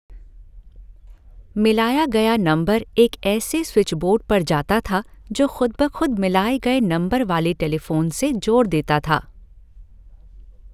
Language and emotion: Hindi, neutral